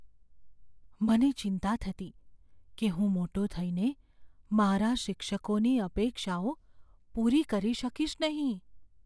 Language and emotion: Gujarati, fearful